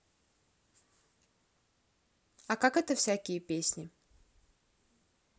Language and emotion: Russian, neutral